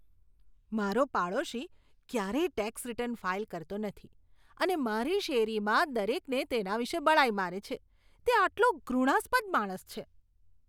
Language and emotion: Gujarati, disgusted